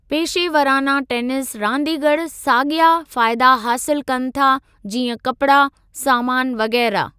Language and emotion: Sindhi, neutral